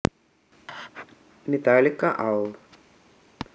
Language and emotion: Russian, neutral